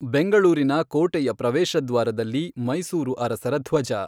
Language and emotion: Kannada, neutral